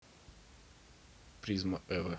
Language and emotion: Russian, neutral